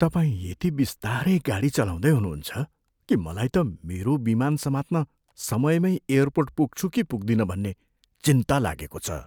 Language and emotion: Nepali, fearful